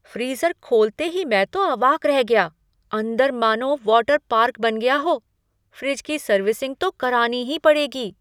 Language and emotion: Hindi, surprised